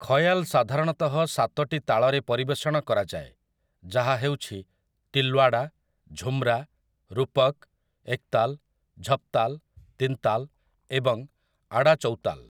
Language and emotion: Odia, neutral